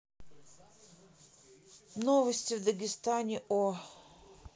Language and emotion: Russian, neutral